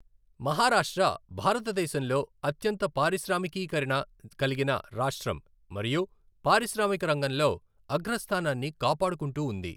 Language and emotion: Telugu, neutral